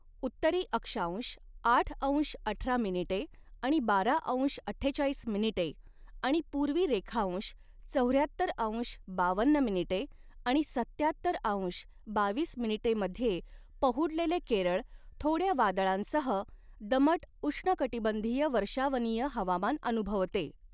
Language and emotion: Marathi, neutral